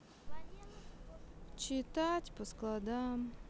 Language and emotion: Russian, sad